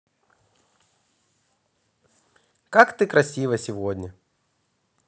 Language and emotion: Russian, positive